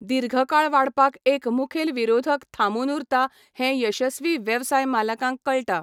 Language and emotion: Goan Konkani, neutral